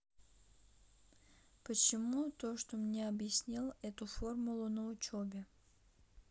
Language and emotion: Russian, neutral